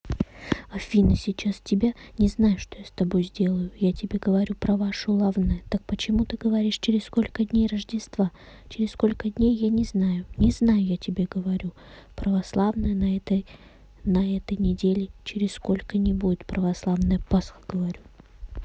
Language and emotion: Russian, neutral